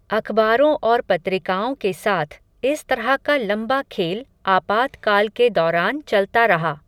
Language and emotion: Hindi, neutral